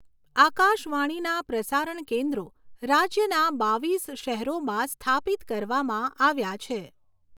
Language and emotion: Gujarati, neutral